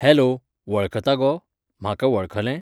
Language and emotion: Goan Konkani, neutral